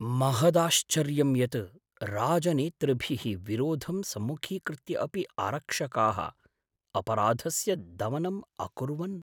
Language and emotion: Sanskrit, surprised